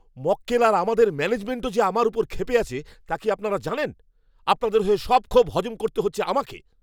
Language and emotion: Bengali, angry